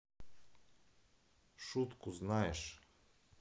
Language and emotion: Russian, neutral